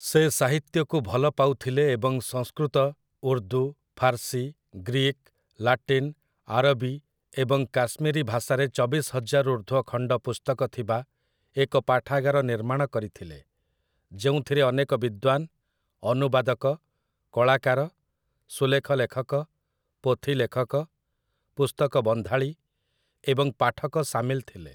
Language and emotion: Odia, neutral